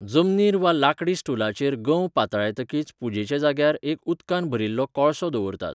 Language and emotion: Goan Konkani, neutral